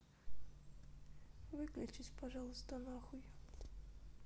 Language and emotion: Russian, sad